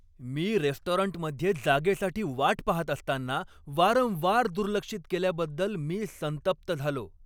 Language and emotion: Marathi, angry